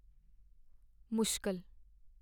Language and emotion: Punjabi, sad